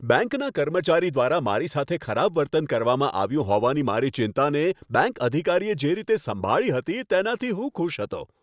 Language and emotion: Gujarati, happy